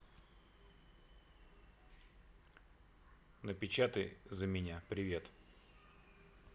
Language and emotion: Russian, neutral